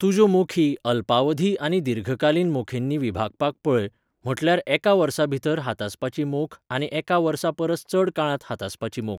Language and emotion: Goan Konkani, neutral